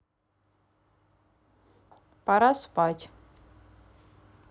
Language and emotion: Russian, neutral